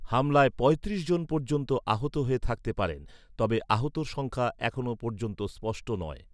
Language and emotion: Bengali, neutral